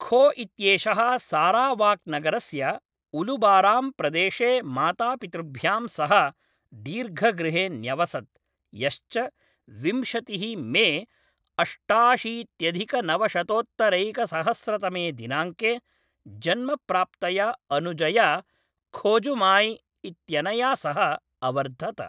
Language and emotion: Sanskrit, neutral